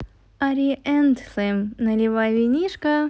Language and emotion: Russian, positive